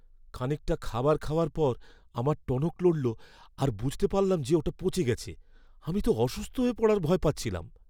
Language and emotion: Bengali, fearful